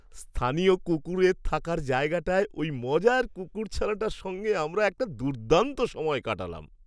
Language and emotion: Bengali, happy